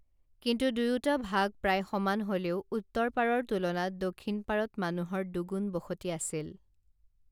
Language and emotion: Assamese, neutral